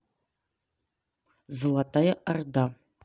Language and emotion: Russian, neutral